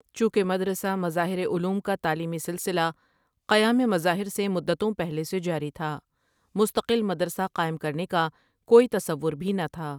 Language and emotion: Urdu, neutral